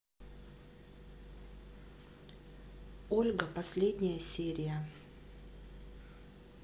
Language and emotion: Russian, neutral